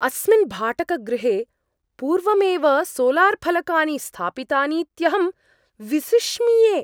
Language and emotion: Sanskrit, surprised